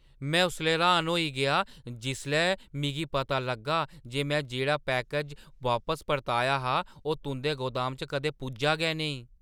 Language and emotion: Dogri, surprised